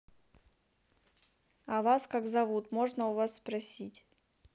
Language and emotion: Russian, neutral